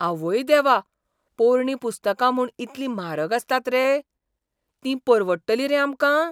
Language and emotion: Goan Konkani, surprised